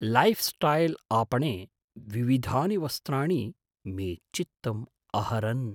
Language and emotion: Sanskrit, surprised